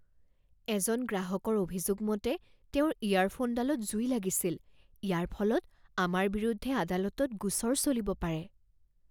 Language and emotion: Assamese, fearful